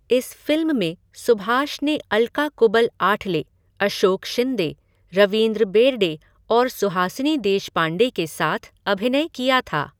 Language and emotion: Hindi, neutral